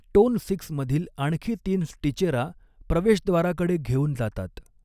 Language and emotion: Marathi, neutral